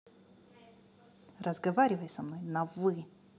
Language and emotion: Russian, angry